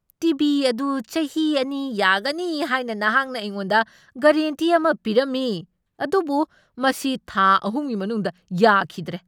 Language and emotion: Manipuri, angry